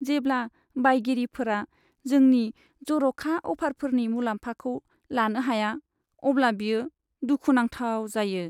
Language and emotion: Bodo, sad